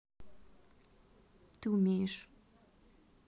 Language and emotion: Russian, neutral